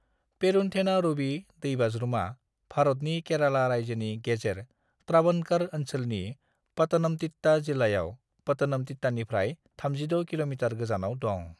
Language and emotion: Bodo, neutral